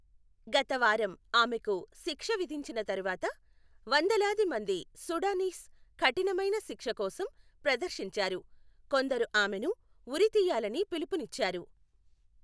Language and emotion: Telugu, neutral